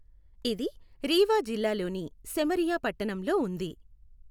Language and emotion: Telugu, neutral